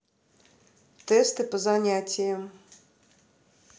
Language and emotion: Russian, neutral